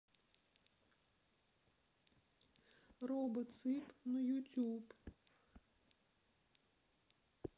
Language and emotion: Russian, sad